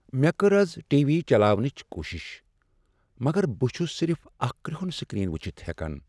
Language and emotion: Kashmiri, sad